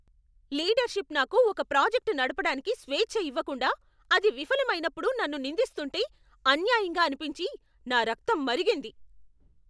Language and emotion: Telugu, angry